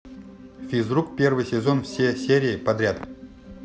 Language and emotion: Russian, neutral